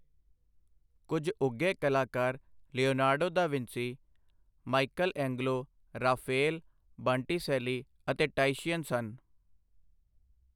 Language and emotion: Punjabi, neutral